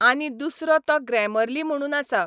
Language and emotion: Goan Konkani, neutral